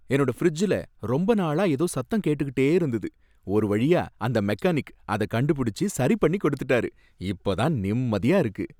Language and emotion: Tamil, happy